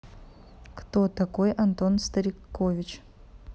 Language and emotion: Russian, neutral